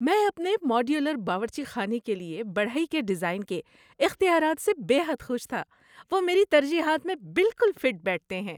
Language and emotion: Urdu, happy